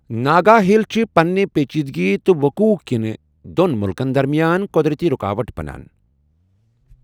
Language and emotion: Kashmiri, neutral